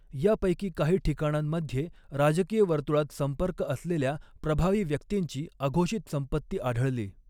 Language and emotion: Marathi, neutral